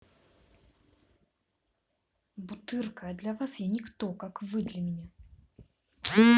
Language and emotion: Russian, angry